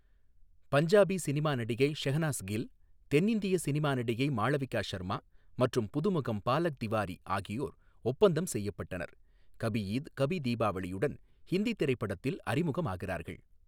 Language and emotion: Tamil, neutral